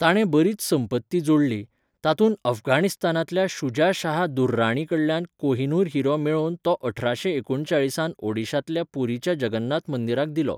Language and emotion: Goan Konkani, neutral